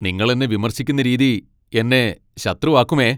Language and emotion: Malayalam, angry